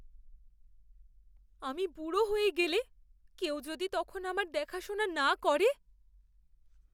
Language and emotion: Bengali, fearful